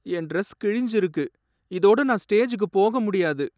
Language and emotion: Tamil, sad